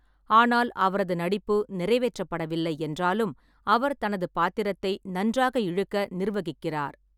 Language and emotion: Tamil, neutral